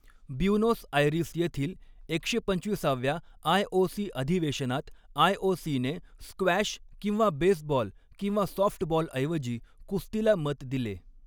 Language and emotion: Marathi, neutral